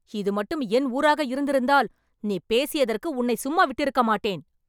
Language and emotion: Tamil, angry